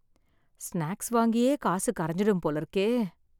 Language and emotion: Tamil, sad